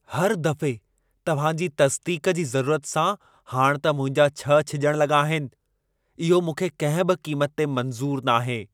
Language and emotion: Sindhi, angry